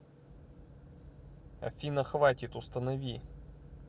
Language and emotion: Russian, neutral